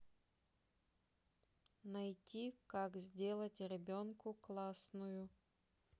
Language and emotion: Russian, neutral